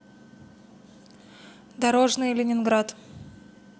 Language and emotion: Russian, neutral